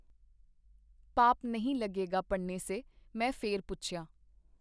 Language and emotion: Punjabi, neutral